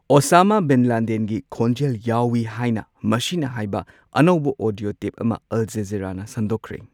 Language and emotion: Manipuri, neutral